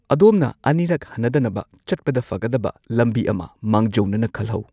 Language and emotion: Manipuri, neutral